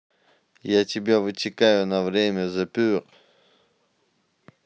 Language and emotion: Russian, neutral